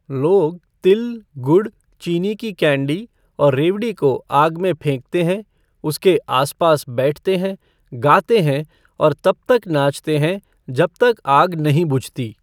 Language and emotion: Hindi, neutral